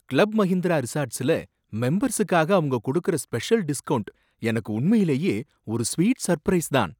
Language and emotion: Tamil, surprised